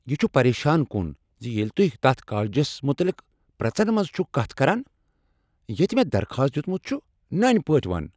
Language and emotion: Kashmiri, angry